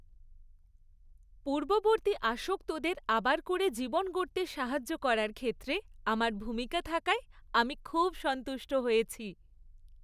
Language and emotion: Bengali, happy